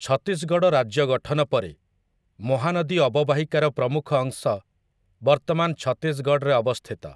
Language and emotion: Odia, neutral